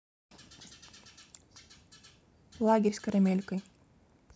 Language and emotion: Russian, neutral